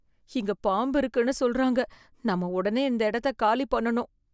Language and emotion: Tamil, fearful